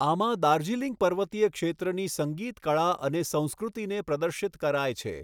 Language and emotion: Gujarati, neutral